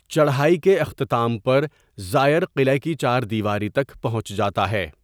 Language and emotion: Urdu, neutral